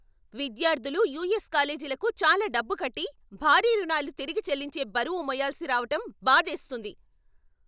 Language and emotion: Telugu, angry